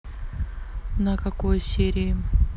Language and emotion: Russian, neutral